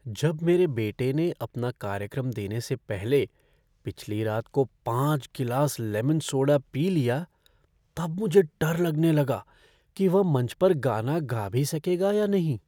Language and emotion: Hindi, fearful